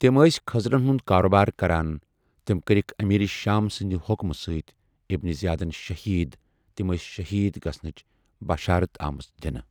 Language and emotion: Kashmiri, neutral